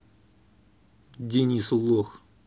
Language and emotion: Russian, angry